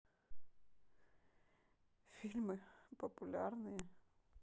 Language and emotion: Russian, sad